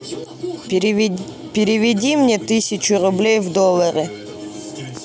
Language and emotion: Russian, neutral